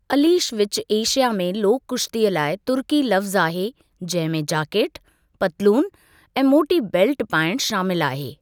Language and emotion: Sindhi, neutral